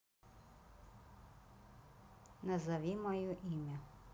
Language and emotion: Russian, neutral